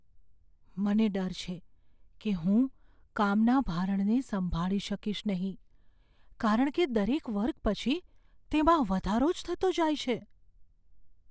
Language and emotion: Gujarati, fearful